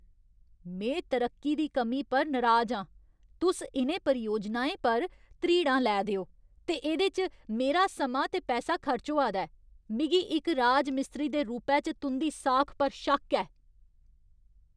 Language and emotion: Dogri, angry